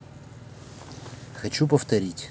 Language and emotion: Russian, neutral